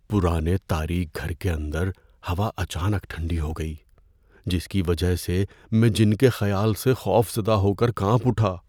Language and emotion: Urdu, fearful